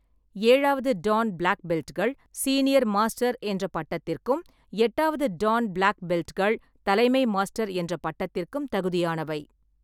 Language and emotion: Tamil, neutral